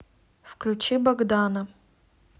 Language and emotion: Russian, neutral